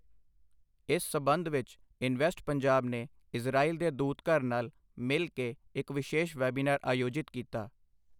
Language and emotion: Punjabi, neutral